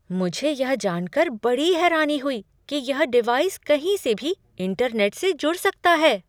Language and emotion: Hindi, surprised